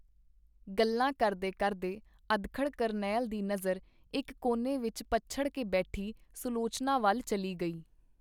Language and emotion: Punjabi, neutral